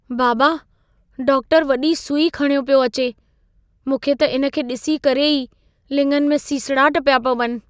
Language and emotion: Sindhi, fearful